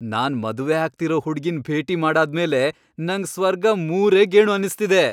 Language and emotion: Kannada, happy